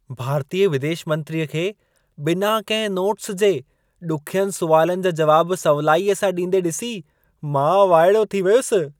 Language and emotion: Sindhi, surprised